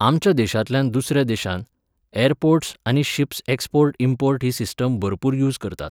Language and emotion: Goan Konkani, neutral